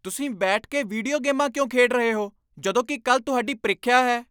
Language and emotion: Punjabi, angry